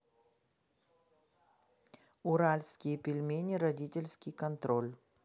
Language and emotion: Russian, neutral